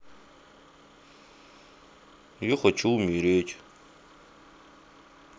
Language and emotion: Russian, sad